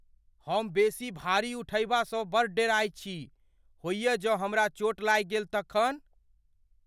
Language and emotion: Maithili, fearful